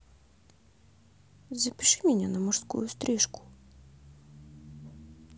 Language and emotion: Russian, neutral